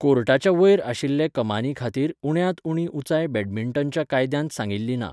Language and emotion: Goan Konkani, neutral